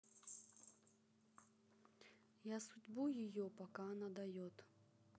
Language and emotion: Russian, neutral